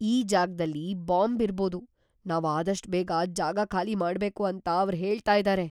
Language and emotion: Kannada, fearful